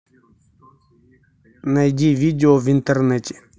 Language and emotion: Russian, neutral